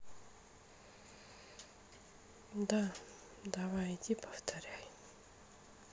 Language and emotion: Russian, sad